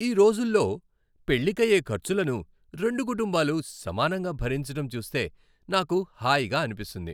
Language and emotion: Telugu, happy